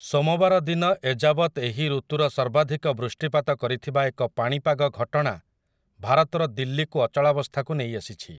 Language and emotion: Odia, neutral